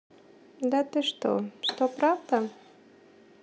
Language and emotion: Russian, neutral